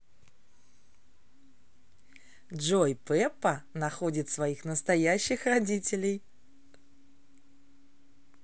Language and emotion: Russian, positive